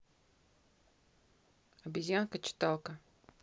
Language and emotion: Russian, neutral